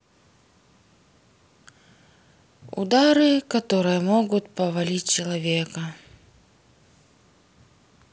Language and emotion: Russian, sad